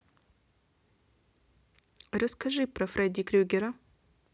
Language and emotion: Russian, neutral